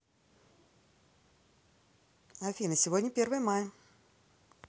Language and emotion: Russian, positive